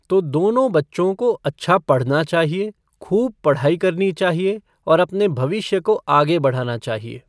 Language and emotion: Hindi, neutral